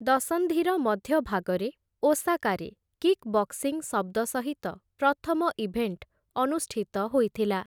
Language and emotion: Odia, neutral